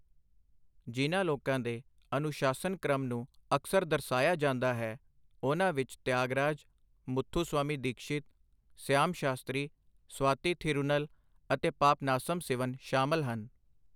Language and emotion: Punjabi, neutral